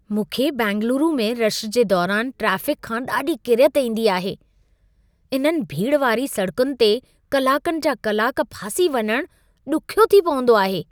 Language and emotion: Sindhi, disgusted